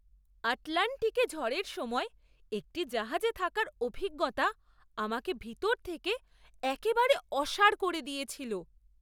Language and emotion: Bengali, surprised